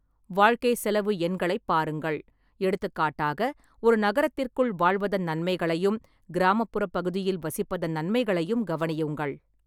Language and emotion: Tamil, neutral